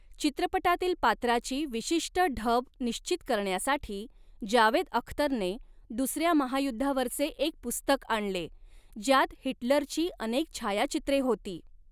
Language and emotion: Marathi, neutral